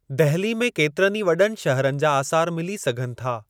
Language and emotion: Sindhi, neutral